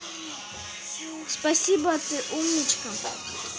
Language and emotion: Russian, positive